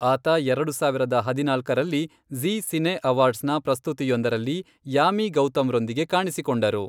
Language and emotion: Kannada, neutral